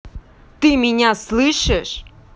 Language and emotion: Russian, angry